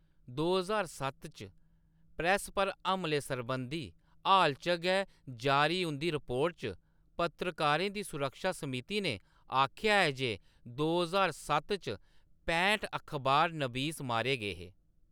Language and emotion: Dogri, neutral